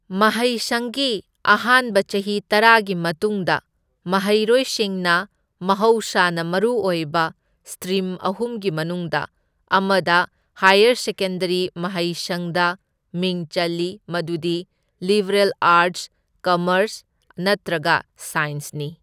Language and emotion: Manipuri, neutral